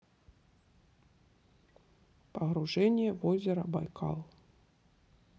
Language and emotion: Russian, neutral